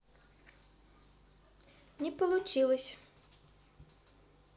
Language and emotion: Russian, neutral